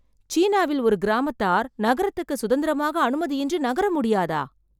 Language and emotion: Tamil, surprised